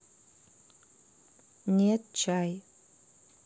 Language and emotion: Russian, neutral